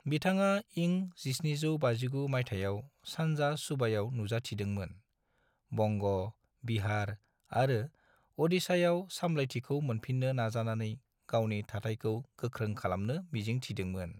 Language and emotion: Bodo, neutral